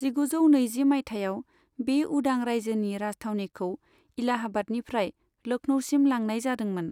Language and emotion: Bodo, neutral